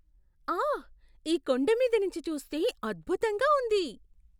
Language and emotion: Telugu, surprised